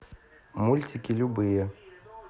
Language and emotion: Russian, neutral